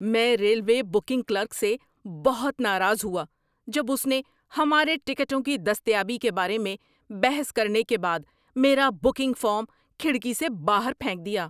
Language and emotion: Urdu, angry